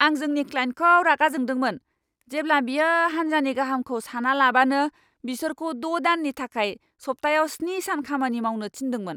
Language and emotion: Bodo, angry